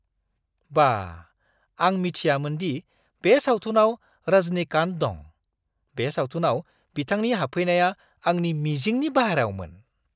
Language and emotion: Bodo, surprised